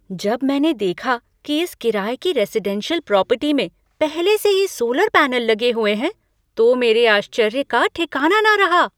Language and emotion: Hindi, surprised